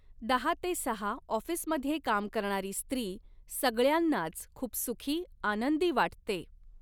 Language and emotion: Marathi, neutral